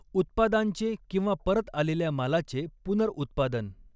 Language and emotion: Marathi, neutral